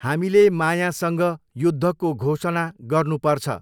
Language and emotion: Nepali, neutral